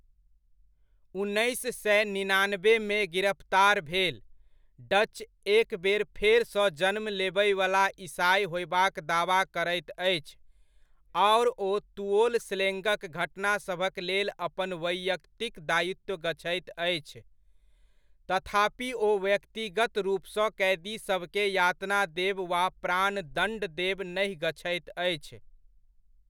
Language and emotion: Maithili, neutral